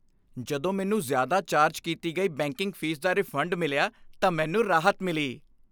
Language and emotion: Punjabi, happy